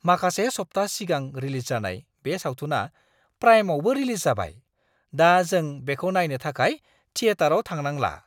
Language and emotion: Bodo, surprised